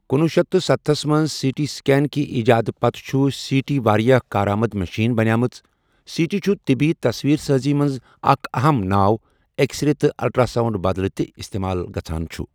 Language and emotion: Kashmiri, neutral